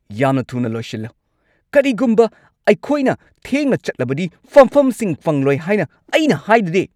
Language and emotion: Manipuri, angry